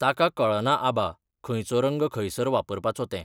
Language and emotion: Goan Konkani, neutral